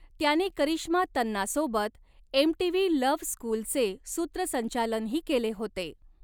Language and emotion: Marathi, neutral